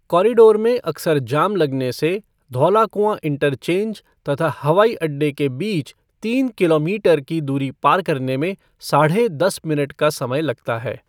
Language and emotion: Hindi, neutral